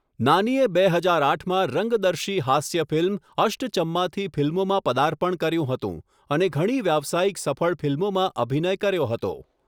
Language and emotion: Gujarati, neutral